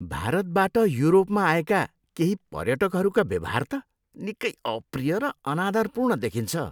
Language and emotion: Nepali, disgusted